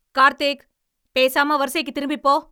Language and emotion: Tamil, angry